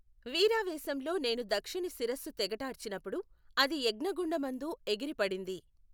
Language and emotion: Telugu, neutral